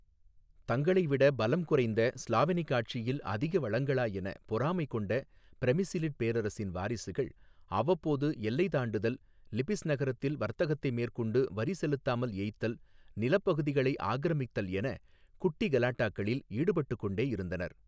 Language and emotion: Tamil, neutral